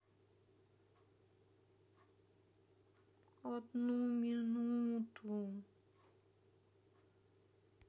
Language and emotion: Russian, sad